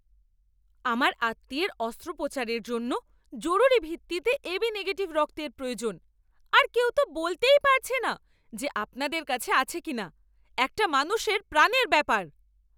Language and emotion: Bengali, angry